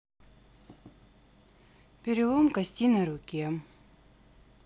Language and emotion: Russian, neutral